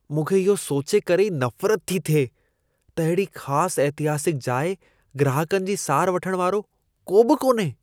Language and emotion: Sindhi, disgusted